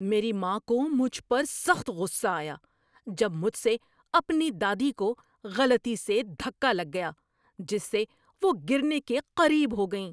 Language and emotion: Urdu, angry